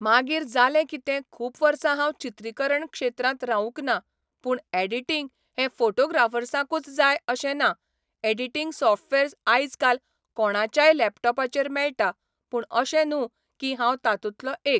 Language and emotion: Goan Konkani, neutral